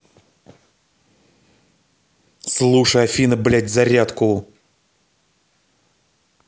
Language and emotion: Russian, angry